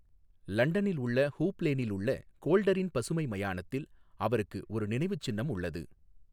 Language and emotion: Tamil, neutral